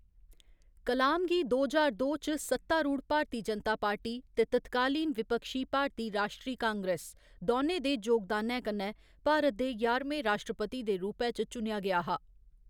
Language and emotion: Dogri, neutral